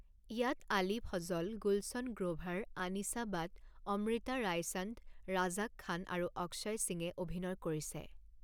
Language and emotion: Assamese, neutral